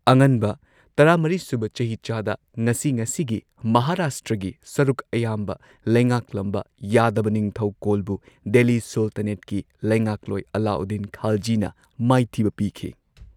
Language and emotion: Manipuri, neutral